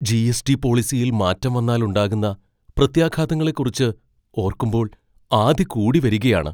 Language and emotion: Malayalam, fearful